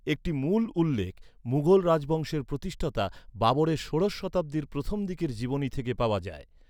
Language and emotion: Bengali, neutral